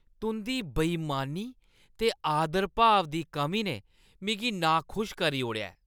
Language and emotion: Dogri, disgusted